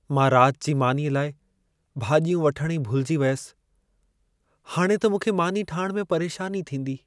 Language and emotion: Sindhi, sad